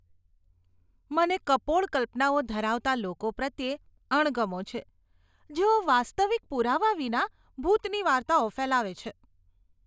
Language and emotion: Gujarati, disgusted